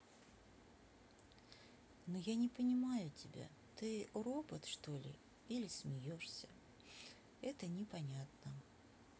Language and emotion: Russian, sad